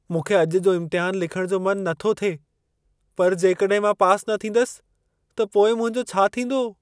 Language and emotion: Sindhi, fearful